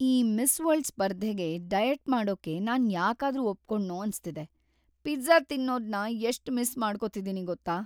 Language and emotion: Kannada, sad